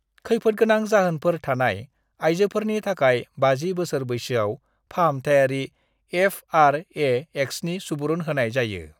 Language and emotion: Bodo, neutral